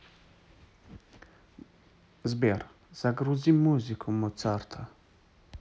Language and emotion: Russian, neutral